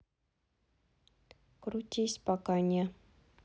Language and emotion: Russian, neutral